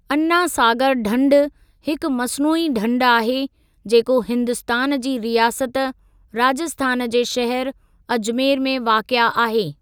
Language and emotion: Sindhi, neutral